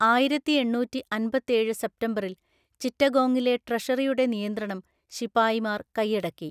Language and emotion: Malayalam, neutral